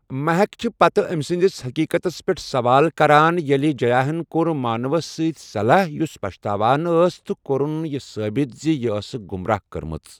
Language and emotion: Kashmiri, neutral